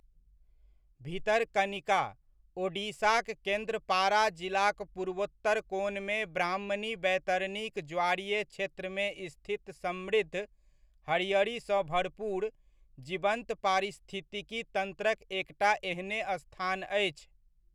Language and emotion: Maithili, neutral